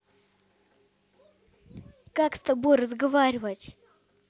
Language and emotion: Russian, angry